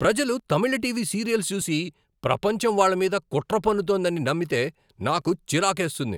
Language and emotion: Telugu, angry